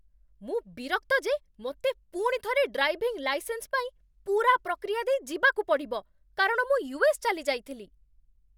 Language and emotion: Odia, angry